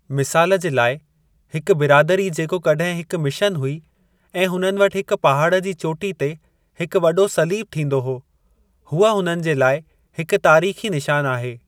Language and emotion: Sindhi, neutral